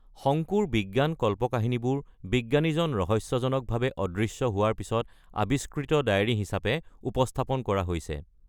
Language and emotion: Assamese, neutral